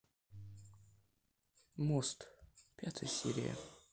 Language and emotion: Russian, neutral